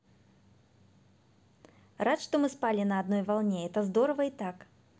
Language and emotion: Russian, positive